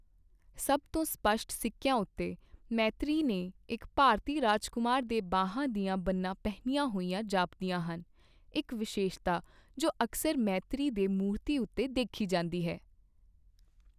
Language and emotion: Punjabi, neutral